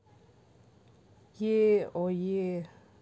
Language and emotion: Russian, neutral